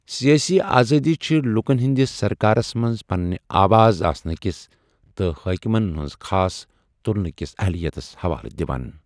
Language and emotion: Kashmiri, neutral